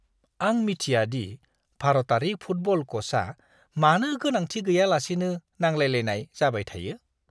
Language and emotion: Bodo, disgusted